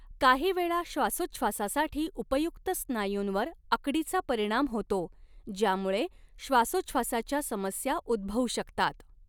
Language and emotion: Marathi, neutral